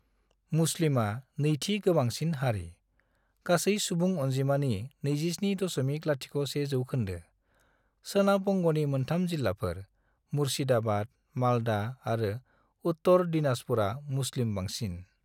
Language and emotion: Bodo, neutral